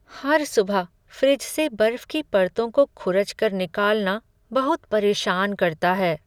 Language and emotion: Hindi, sad